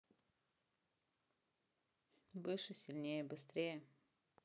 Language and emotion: Russian, neutral